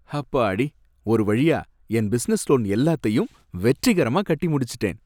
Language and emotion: Tamil, happy